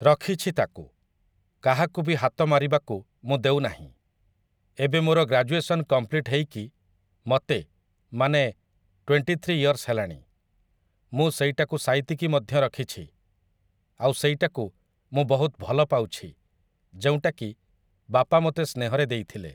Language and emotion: Odia, neutral